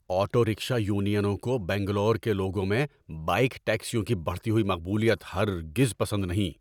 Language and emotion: Urdu, angry